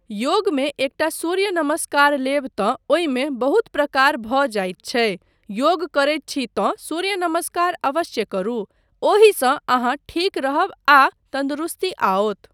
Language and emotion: Maithili, neutral